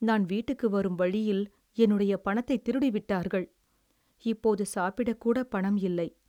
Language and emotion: Tamil, sad